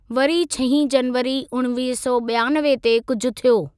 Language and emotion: Sindhi, neutral